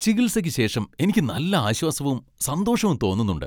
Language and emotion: Malayalam, happy